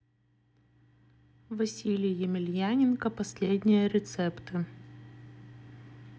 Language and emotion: Russian, neutral